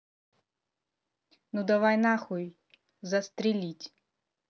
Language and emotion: Russian, angry